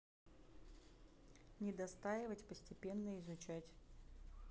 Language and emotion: Russian, neutral